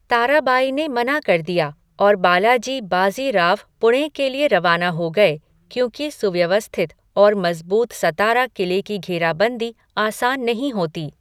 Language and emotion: Hindi, neutral